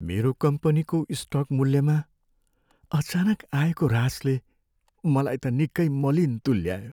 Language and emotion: Nepali, sad